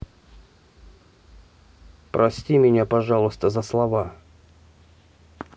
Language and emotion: Russian, neutral